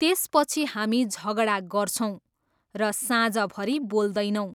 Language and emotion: Nepali, neutral